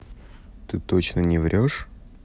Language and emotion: Russian, neutral